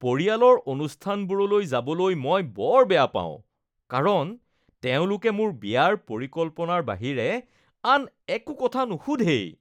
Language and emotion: Assamese, disgusted